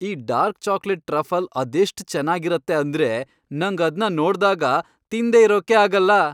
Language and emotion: Kannada, happy